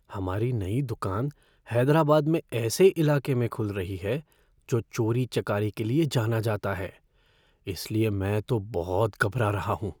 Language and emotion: Hindi, fearful